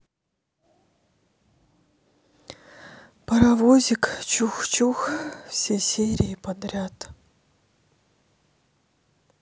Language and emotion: Russian, sad